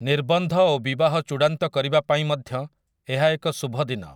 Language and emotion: Odia, neutral